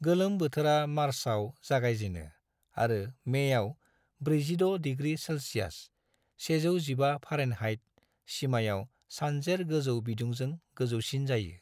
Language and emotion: Bodo, neutral